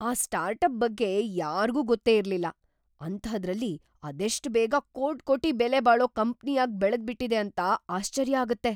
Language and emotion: Kannada, surprised